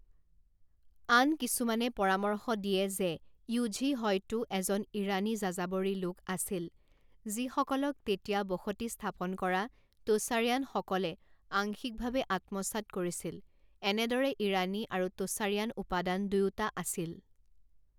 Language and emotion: Assamese, neutral